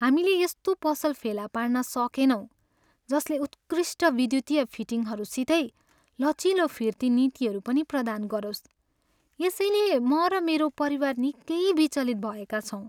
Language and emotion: Nepali, sad